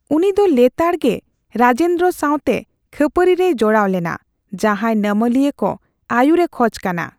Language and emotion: Santali, neutral